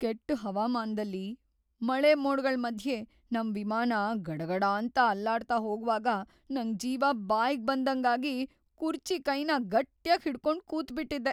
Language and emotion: Kannada, fearful